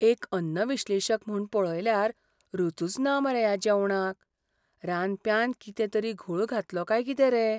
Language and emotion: Goan Konkani, fearful